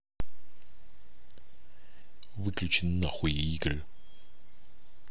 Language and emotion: Russian, angry